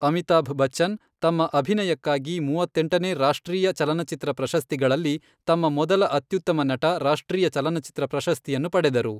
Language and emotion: Kannada, neutral